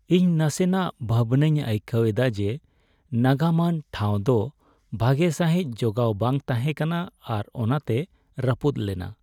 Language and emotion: Santali, sad